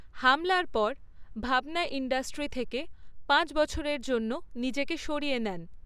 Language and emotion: Bengali, neutral